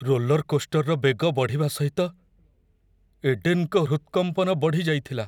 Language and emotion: Odia, fearful